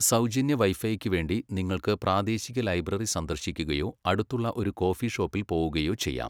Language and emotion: Malayalam, neutral